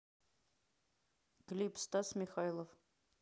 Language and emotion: Russian, neutral